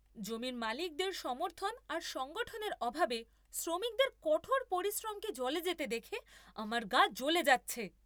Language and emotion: Bengali, angry